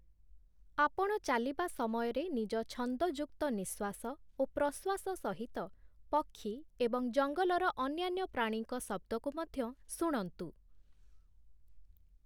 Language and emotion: Odia, neutral